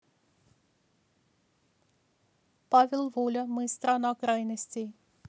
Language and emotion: Russian, neutral